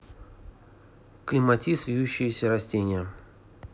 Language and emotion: Russian, neutral